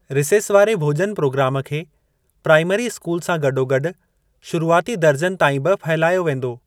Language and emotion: Sindhi, neutral